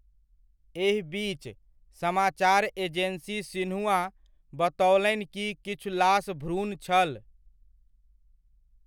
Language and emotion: Maithili, neutral